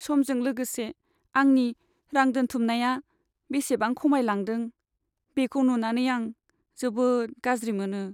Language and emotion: Bodo, sad